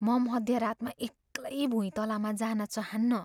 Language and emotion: Nepali, fearful